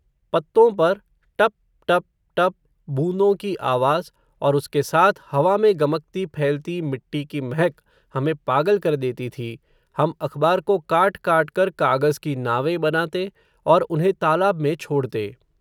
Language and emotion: Hindi, neutral